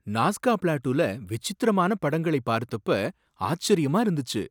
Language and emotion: Tamil, surprised